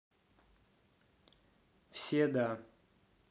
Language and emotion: Russian, neutral